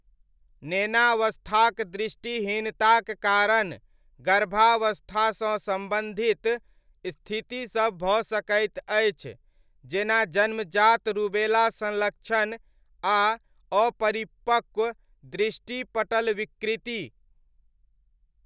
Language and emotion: Maithili, neutral